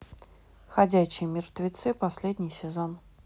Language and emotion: Russian, neutral